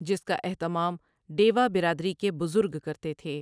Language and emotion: Urdu, neutral